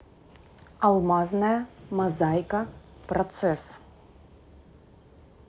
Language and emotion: Russian, neutral